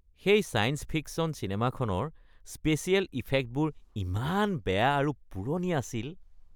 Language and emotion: Assamese, disgusted